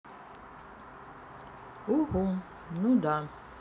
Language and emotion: Russian, sad